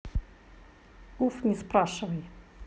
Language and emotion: Russian, neutral